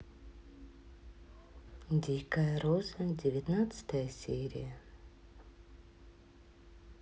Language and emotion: Russian, neutral